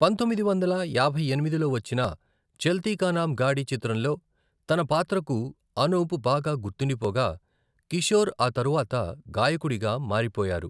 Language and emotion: Telugu, neutral